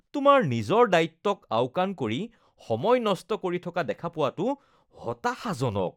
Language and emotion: Assamese, disgusted